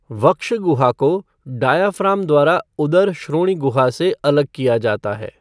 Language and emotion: Hindi, neutral